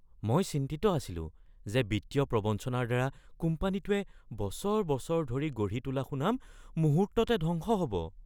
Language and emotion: Assamese, fearful